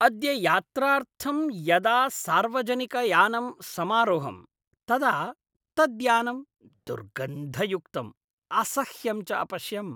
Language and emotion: Sanskrit, disgusted